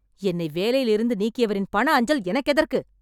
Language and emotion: Tamil, angry